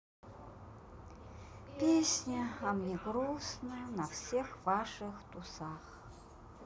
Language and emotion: Russian, sad